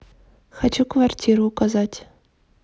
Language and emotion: Russian, neutral